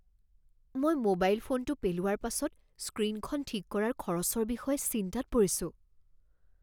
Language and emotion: Assamese, fearful